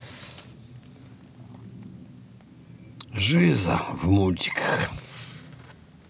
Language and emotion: Russian, sad